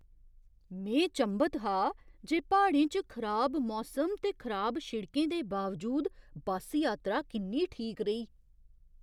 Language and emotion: Dogri, surprised